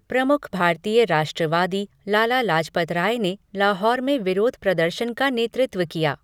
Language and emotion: Hindi, neutral